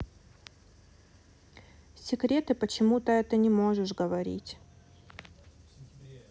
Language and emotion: Russian, sad